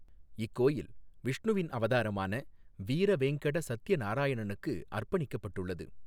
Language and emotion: Tamil, neutral